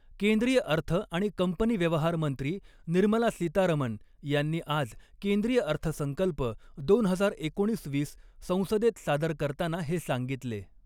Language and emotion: Marathi, neutral